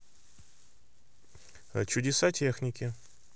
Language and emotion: Russian, neutral